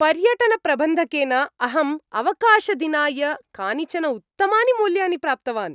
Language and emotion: Sanskrit, happy